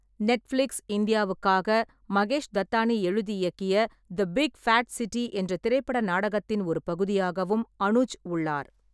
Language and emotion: Tamil, neutral